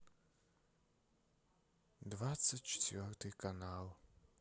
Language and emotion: Russian, sad